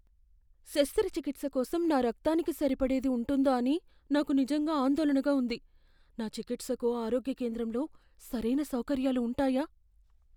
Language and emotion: Telugu, fearful